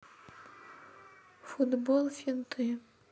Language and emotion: Russian, sad